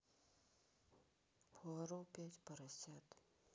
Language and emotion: Russian, sad